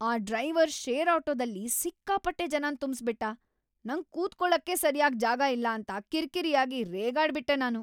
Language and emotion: Kannada, angry